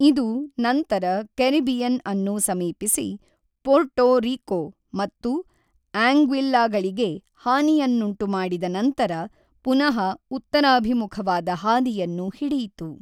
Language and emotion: Kannada, neutral